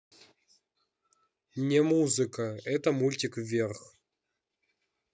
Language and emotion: Russian, neutral